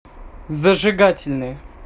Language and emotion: Russian, neutral